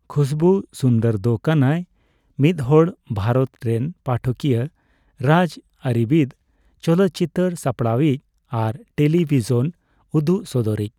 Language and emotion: Santali, neutral